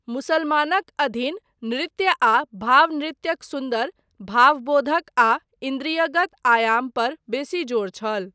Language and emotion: Maithili, neutral